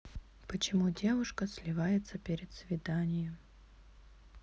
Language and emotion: Russian, sad